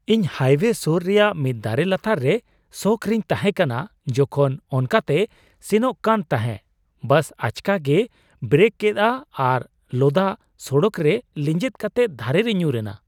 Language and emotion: Santali, surprised